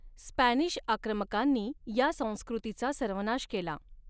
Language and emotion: Marathi, neutral